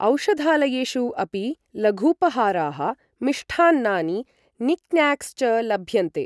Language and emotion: Sanskrit, neutral